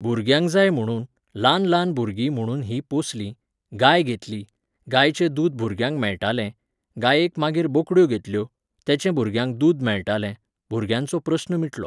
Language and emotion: Goan Konkani, neutral